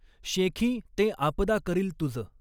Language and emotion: Marathi, neutral